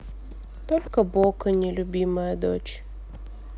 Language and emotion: Russian, sad